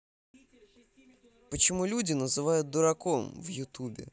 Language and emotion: Russian, neutral